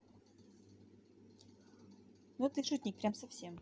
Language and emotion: Russian, neutral